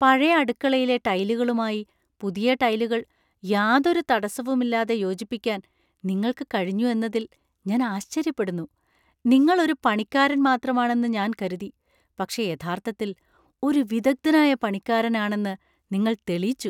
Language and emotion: Malayalam, surprised